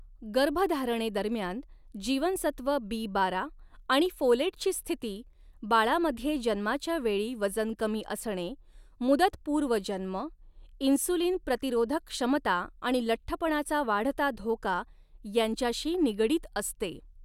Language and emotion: Marathi, neutral